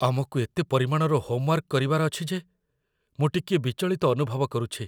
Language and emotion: Odia, fearful